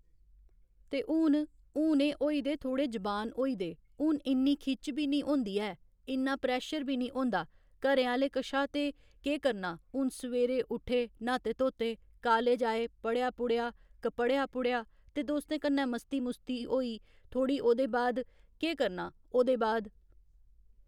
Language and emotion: Dogri, neutral